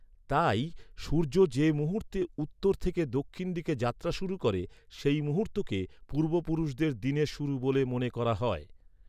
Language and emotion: Bengali, neutral